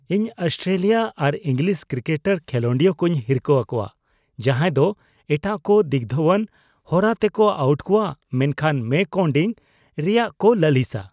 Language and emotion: Santali, disgusted